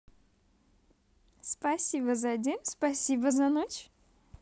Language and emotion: Russian, positive